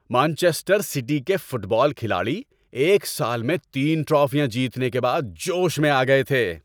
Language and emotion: Urdu, happy